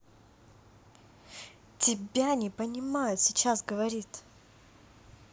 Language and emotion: Russian, angry